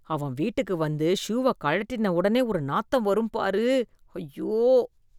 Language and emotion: Tamil, disgusted